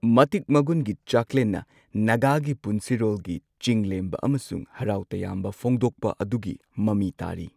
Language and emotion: Manipuri, neutral